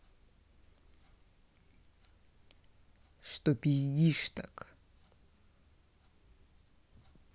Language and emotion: Russian, angry